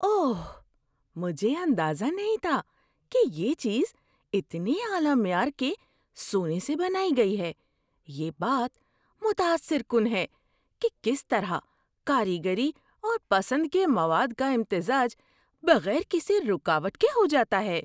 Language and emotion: Urdu, surprised